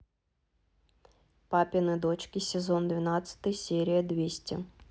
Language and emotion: Russian, neutral